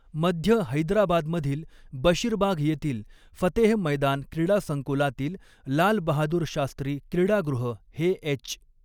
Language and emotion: Marathi, neutral